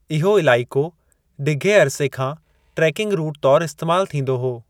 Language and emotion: Sindhi, neutral